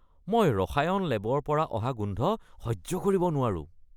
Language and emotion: Assamese, disgusted